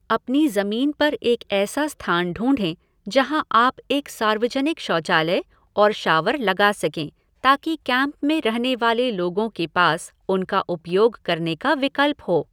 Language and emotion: Hindi, neutral